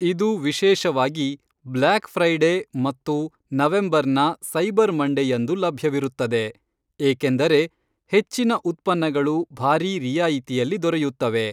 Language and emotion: Kannada, neutral